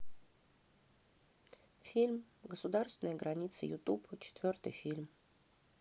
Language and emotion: Russian, neutral